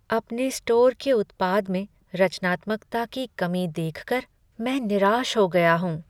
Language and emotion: Hindi, sad